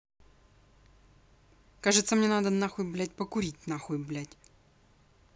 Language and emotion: Russian, angry